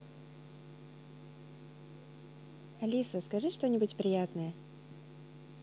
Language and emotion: Russian, positive